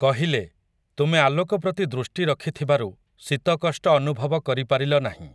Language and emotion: Odia, neutral